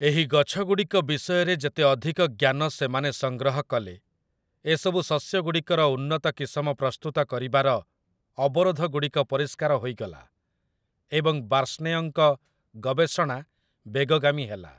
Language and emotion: Odia, neutral